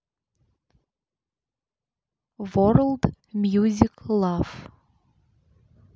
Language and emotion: Russian, neutral